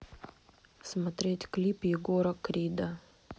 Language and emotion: Russian, neutral